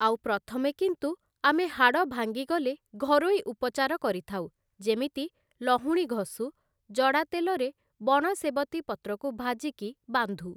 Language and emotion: Odia, neutral